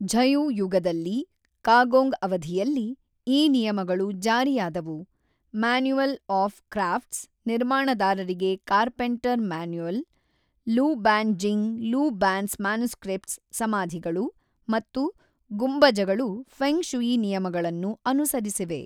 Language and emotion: Kannada, neutral